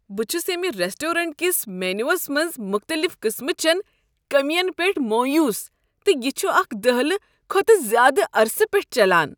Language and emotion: Kashmiri, disgusted